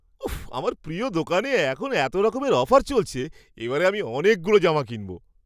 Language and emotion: Bengali, surprised